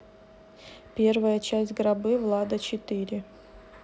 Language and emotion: Russian, neutral